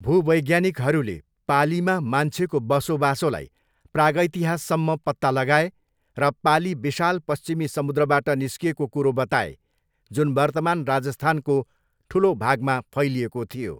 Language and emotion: Nepali, neutral